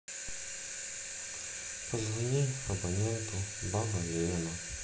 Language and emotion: Russian, sad